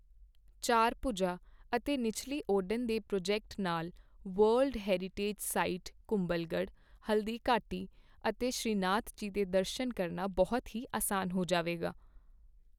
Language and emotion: Punjabi, neutral